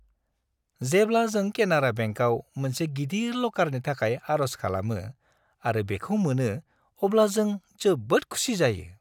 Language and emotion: Bodo, happy